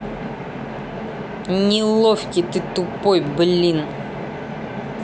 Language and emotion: Russian, angry